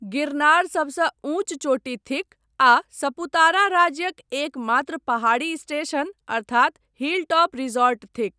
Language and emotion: Maithili, neutral